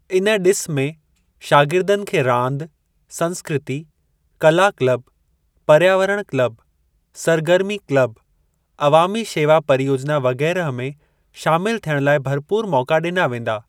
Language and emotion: Sindhi, neutral